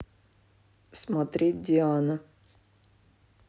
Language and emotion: Russian, neutral